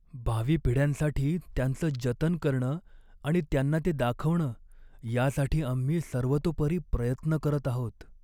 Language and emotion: Marathi, sad